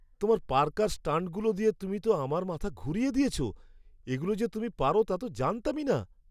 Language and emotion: Bengali, surprised